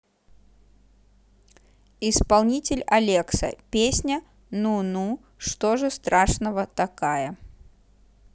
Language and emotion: Russian, neutral